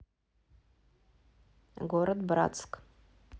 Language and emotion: Russian, neutral